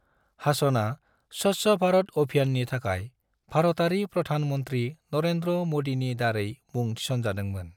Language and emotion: Bodo, neutral